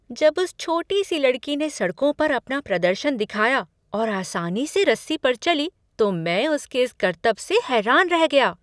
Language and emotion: Hindi, surprised